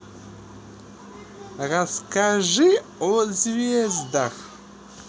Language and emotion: Russian, positive